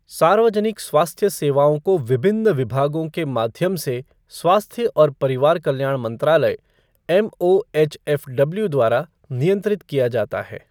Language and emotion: Hindi, neutral